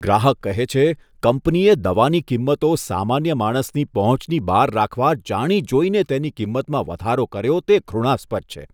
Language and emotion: Gujarati, disgusted